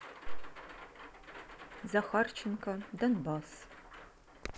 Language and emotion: Russian, neutral